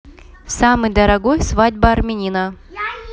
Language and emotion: Russian, neutral